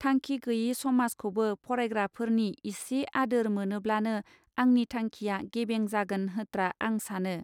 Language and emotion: Bodo, neutral